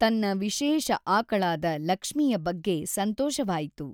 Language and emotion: Kannada, neutral